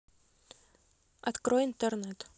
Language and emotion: Russian, neutral